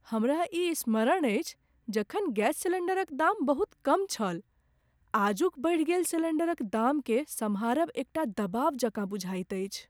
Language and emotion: Maithili, sad